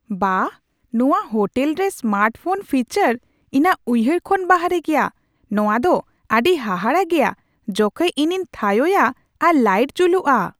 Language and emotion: Santali, surprised